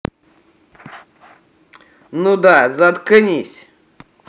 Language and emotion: Russian, angry